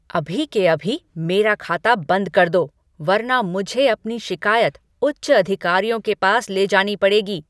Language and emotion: Hindi, angry